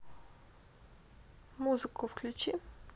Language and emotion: Russian, neutral